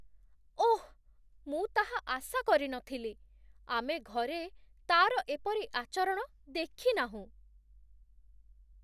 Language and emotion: Odia, surprised